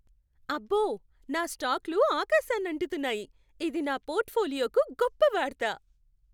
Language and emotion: Telugu, happy